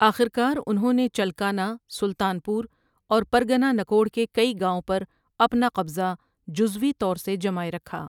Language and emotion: Urdu, neutral